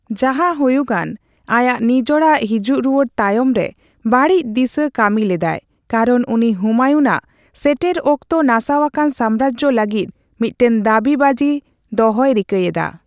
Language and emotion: Santali, neutral